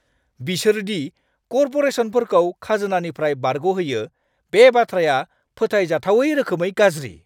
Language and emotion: Bodo, angry